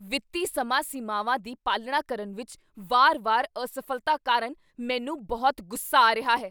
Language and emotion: Punjabi, angry